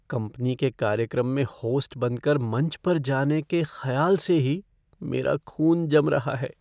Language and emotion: Hindi, fearful